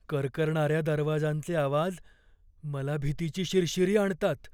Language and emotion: Marathi, fearful